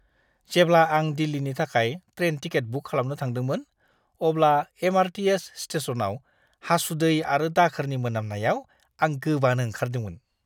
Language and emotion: Bodo, disgusted